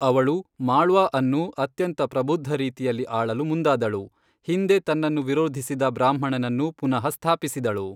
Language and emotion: Kannada, neutral